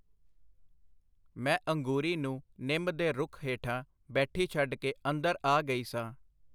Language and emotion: Punjabi, neutral